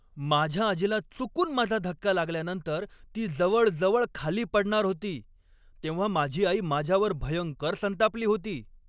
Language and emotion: Marathi, angry